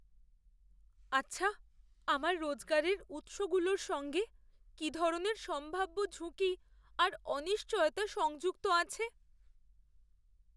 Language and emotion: Bengali, fearful